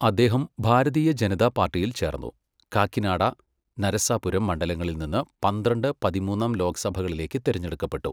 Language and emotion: Malayalam, neutral